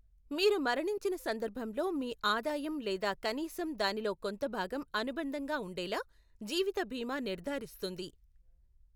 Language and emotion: Telugu, neutral